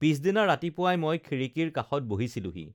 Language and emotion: Assamese, neutral